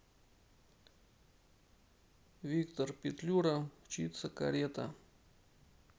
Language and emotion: Russian, neutral